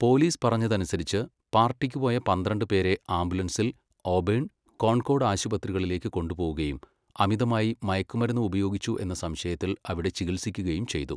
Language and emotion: Malayalam, neutral